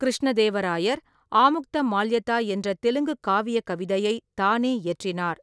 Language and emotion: Tamil, neutral